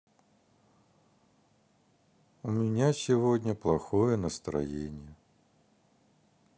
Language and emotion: Russian, sad